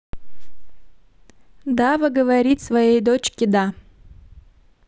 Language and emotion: Russian, neutral